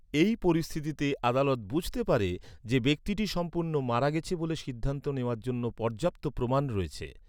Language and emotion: Bengali, neutral